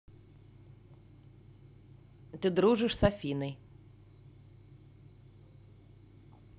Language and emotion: Russian, neutral